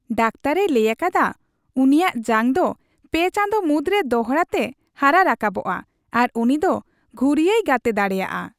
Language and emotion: Santali, happy